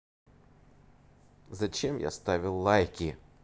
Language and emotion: Russian, neutral